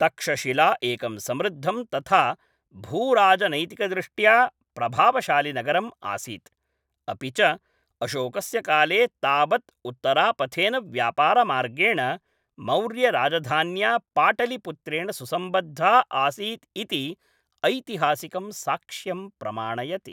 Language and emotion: Sanskrit, neutral